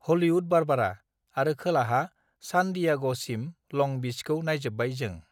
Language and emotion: Bodo, neutral